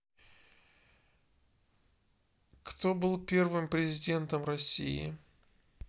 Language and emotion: Russian, neutral